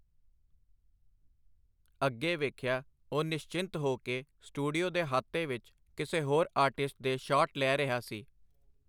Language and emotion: Punjabi, neutral